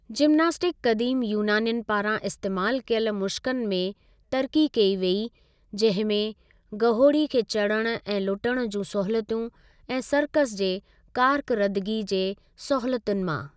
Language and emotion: Sindhi, neutral